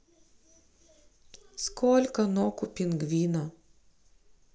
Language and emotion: Russian, neutral